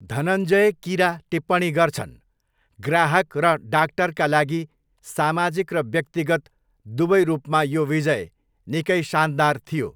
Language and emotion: Nepali, neutral